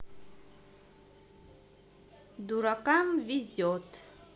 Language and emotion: Russian, neutral